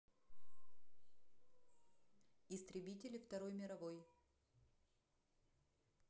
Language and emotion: Russian, neutral